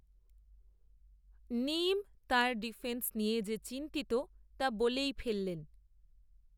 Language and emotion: Bengali, neutral